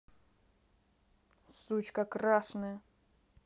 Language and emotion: Russian, angry